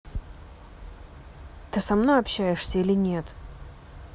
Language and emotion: Russian, angry